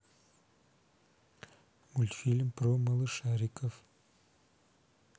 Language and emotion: Russian, neutral